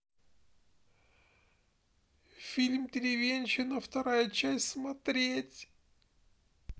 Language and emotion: Russian, sad